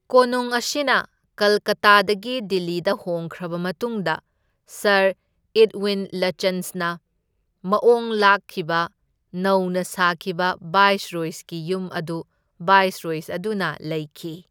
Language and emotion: Manipuri, neutral